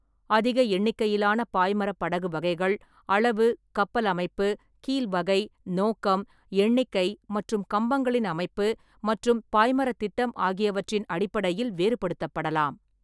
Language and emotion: Tamil, neutral